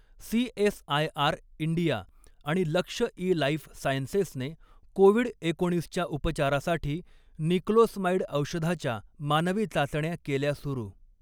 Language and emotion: Marathi, neutral